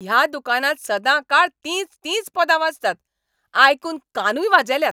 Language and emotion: Goan Konkani, angry